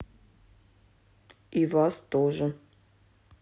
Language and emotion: Russian, neutral